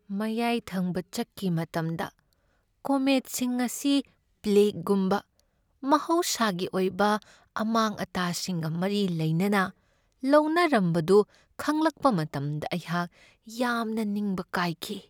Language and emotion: Manipuri, sad